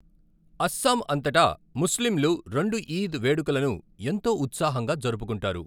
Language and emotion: Telugu, neutral